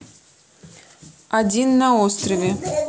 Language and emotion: Russian, neutral